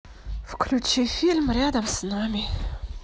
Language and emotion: Russian, sad